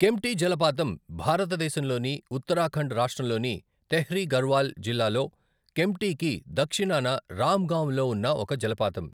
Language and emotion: Telugu, neutral